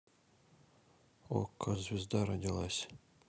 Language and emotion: Russian, neutral